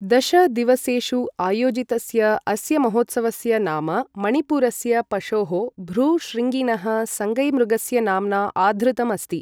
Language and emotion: Sanskrit, neutral